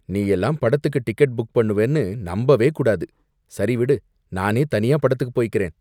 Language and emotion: Tamil, disgusted